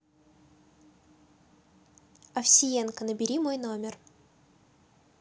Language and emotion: Russian, neutral